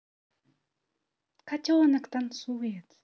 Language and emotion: Russian, positive